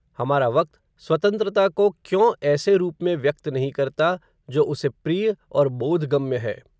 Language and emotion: Hindi, neutral